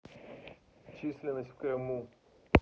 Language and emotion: Russian, neutral